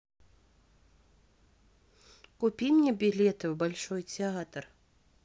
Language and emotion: Russian, neutral